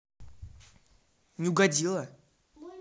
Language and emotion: Russian, angry